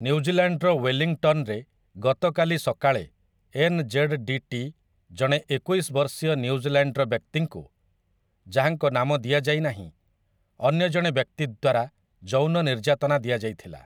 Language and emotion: Odia, neutral